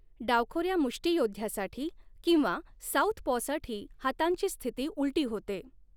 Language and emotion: Marathi, neutral